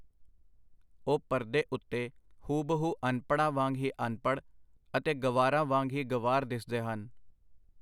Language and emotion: Punjabi, neutral